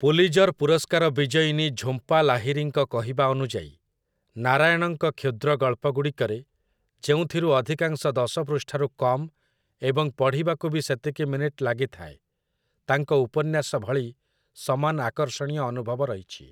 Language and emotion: Odia, neutral